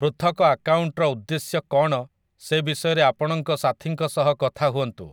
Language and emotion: Odia, neutral